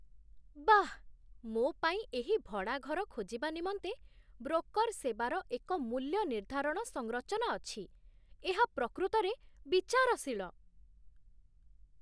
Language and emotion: Odia, surprised